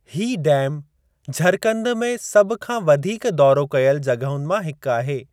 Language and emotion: Sindhi, neutral